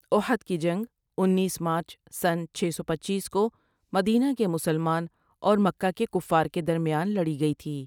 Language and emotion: Urdu, neutral